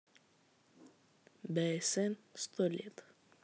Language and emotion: Russian, neutral